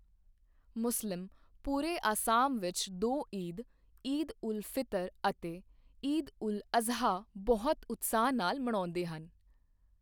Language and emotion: Punjabi, neutral